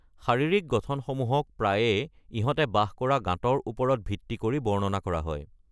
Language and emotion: Assamese, neutral